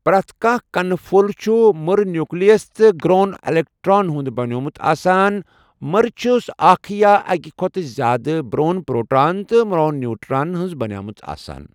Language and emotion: Kashmiri, neutral